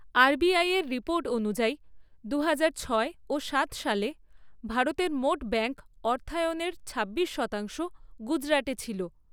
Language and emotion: Bengali, neutral